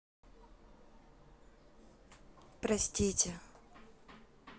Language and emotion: Russian, sad